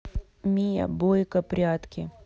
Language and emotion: Russian, neutral